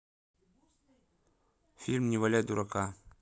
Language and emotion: Russian, neutral